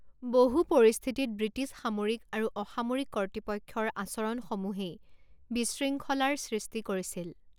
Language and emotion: Assamese, neutral